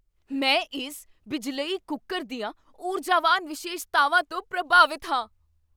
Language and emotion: Punjabi, surprised